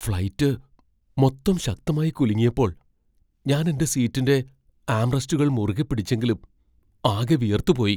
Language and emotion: Malayalam, fearful